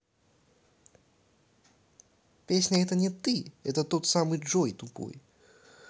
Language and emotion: Russian, angry